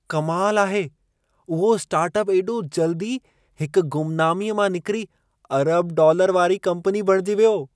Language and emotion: Sindhi, surprised